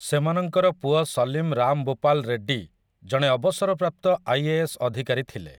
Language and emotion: Odia, neutral